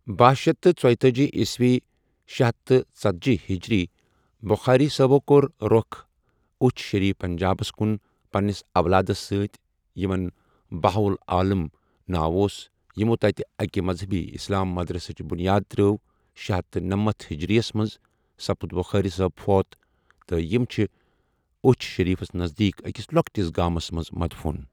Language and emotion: Kashmiri, neutral